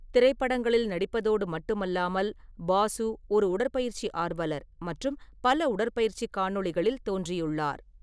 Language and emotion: Tamil, neutral